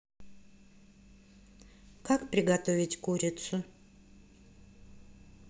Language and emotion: Russian, neutral